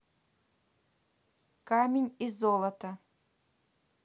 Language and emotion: Russian, neutral